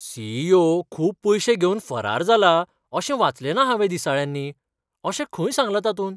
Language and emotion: Goan Konkani, surprised